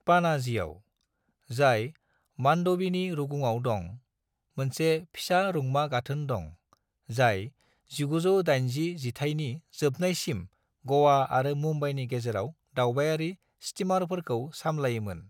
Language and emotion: Bodo, neutral